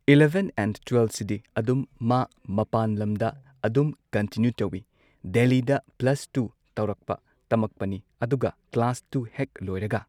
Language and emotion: Manipuri, neutral